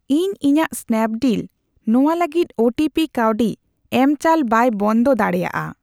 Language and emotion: Santali, neutral